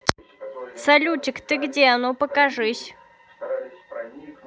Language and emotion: Russian, neutral